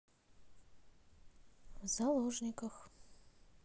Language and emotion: Russian, neutral